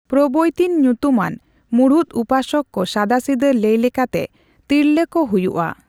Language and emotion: Santali, neutral